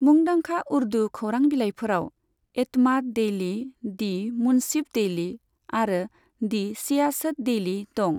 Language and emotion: Bodo, neutral